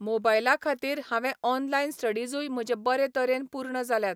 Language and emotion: Goan Konkani, neutral